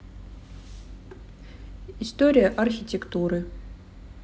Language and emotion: Russian, neutral